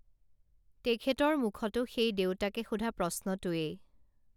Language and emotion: Assamese, neutral